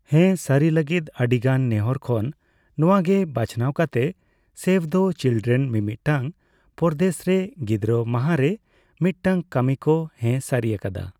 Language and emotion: Santali, neutral